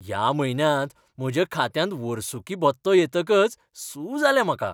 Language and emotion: Goan Konkani, happy